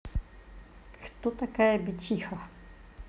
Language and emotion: Russian, neutral